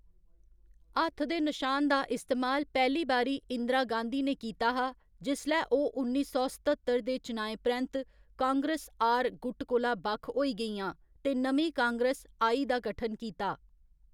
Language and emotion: Dogri, neutral